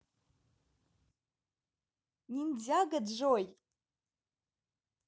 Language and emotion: Russian, positive